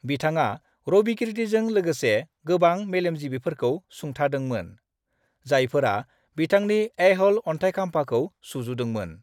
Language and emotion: Bodo, neutral